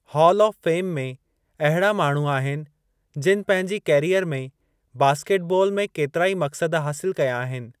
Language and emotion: Sindhi, neutral